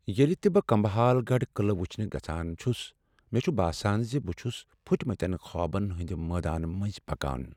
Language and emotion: Kashmiri, sad